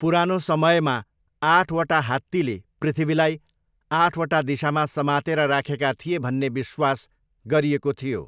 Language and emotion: Nepali, neutral